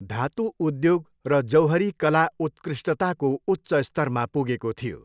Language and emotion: Nepali, neutral